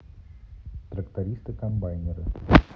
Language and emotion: Russian, neutral